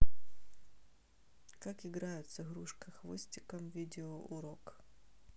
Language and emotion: Russian, neutral